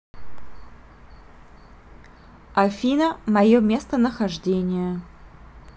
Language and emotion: Russian, neutral